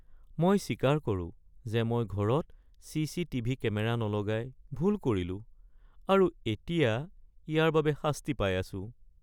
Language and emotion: Assamese, sad